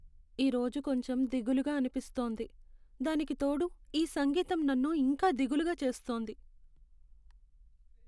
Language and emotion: Telugu, sad